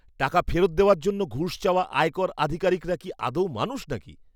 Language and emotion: Bengali, disgusted